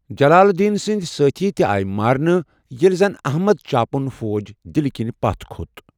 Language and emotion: Kashmiri, neutral